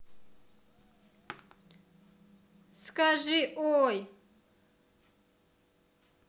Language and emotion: Russian, neutral